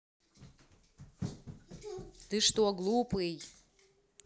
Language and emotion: Russian, angry